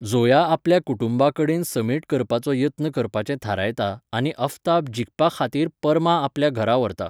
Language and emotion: Goan Konkani, neutral